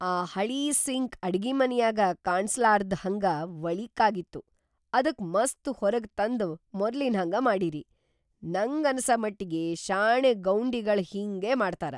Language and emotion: Kannada, surprised